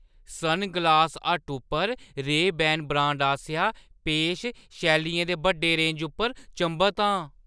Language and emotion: Dogri, surprised